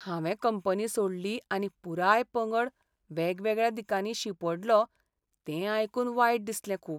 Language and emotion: Goan Konkani, sad